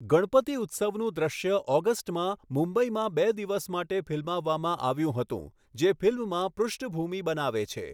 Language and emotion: Gujarati, neutral